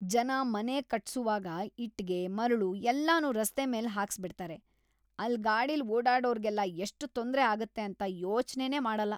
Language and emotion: Kannada, disgusted